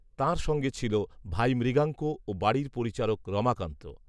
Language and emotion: Bengali, neutral